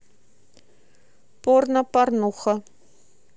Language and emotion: Russian, neutral